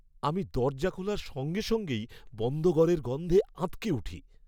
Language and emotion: Bengali, disgusted